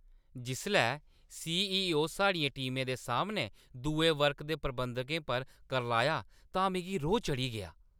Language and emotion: Dogri, angry